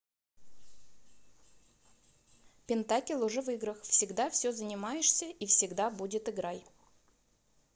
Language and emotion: Russian, neutral